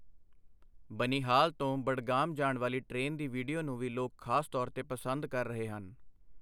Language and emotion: Punjabi, neutral